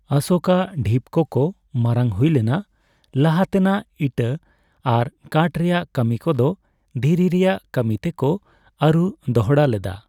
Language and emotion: Santali, neutral